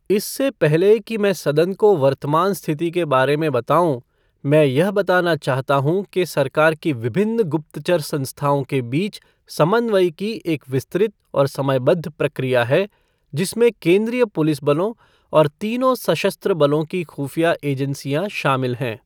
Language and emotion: Hindi, neutral